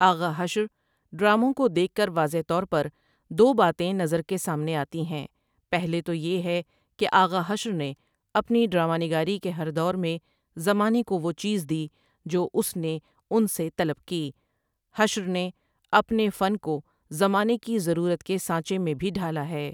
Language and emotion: Urdu, neutral